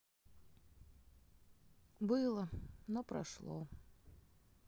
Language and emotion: Russian, sad